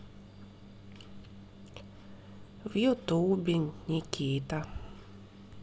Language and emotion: Russian, sad